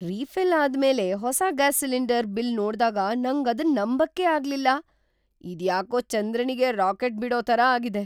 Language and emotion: Kannada, surprised